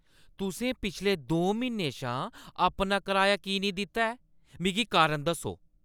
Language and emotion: Dogri, angry